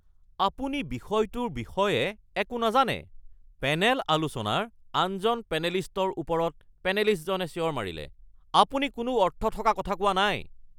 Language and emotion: Assamese, angry